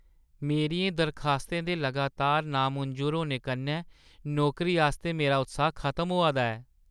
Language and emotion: Dogri, sad